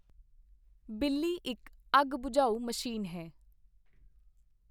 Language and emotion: Punjabi, neutral